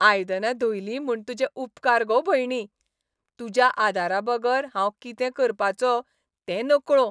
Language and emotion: Goan Konkani, happy